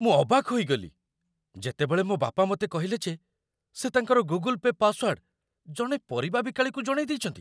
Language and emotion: Odia, surprised